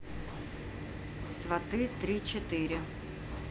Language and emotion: Russian, neutral